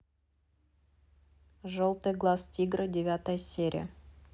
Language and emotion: Russian, neutral